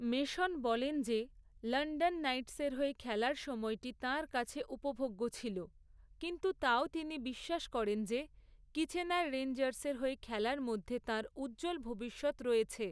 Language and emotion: Bengali, neutral